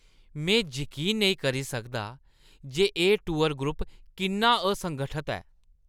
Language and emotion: Dogri, disgusted